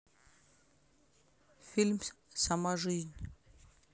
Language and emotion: Russian, neutral